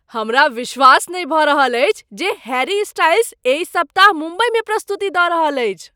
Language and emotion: Maithili, surprised